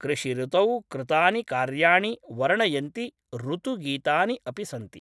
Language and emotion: Sanskrit, neutral